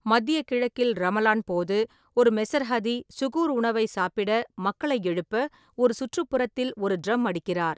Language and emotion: Tamil, neutral